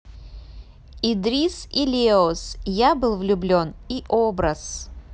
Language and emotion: Russian, neutral